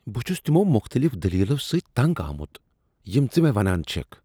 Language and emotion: Kashmiri, disgusted